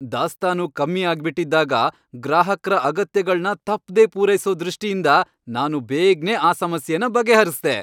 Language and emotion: Kannada, happy